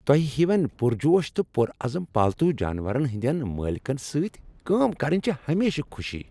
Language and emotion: Kashmiri, happy